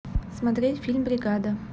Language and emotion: Russian, neutral